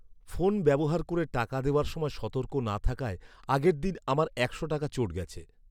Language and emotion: Bengali, sad